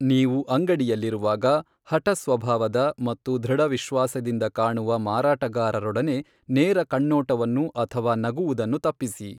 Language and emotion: Kannada, neutral